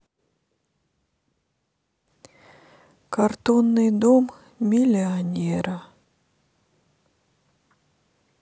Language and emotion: Russian, sad